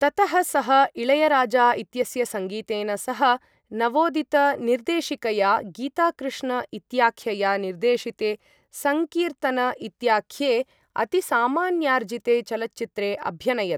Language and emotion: Sanskrit, neutral